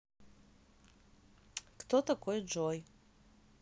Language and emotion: Russian, neutral